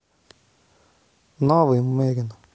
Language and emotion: Russian, neutral